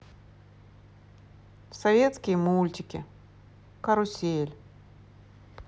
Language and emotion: Russian, neutral